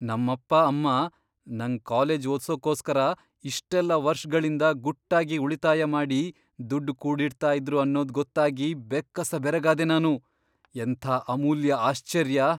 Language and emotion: Kannada, surprised